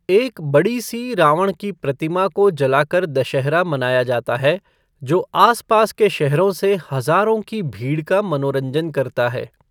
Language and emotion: Hindi, neutral